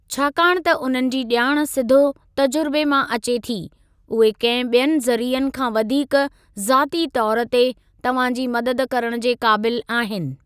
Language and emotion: Sindhi, neutral